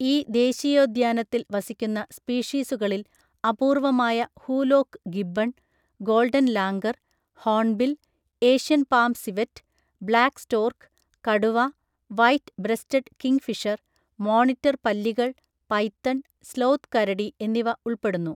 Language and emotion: Malayalam, neutral